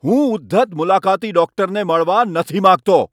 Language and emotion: Gujarati, angry